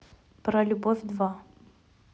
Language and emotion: Russian, neutral